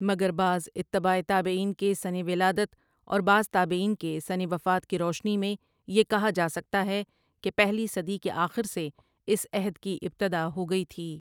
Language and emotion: Urdu, neutral